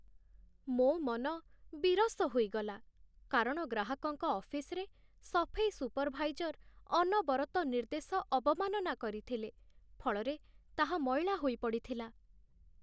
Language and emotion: Odia, sad